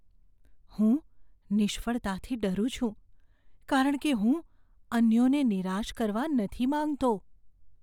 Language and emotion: Gujarati, fearful